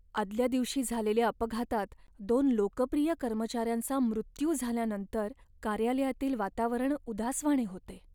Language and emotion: Marathi, sad